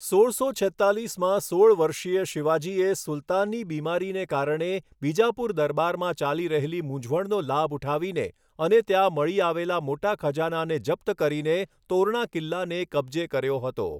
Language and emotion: Gujarati, neutral